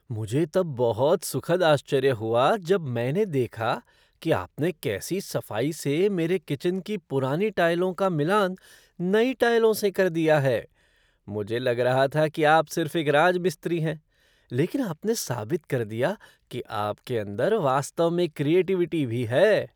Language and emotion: Hindi, surprised